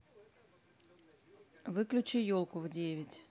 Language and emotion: Russian, neutral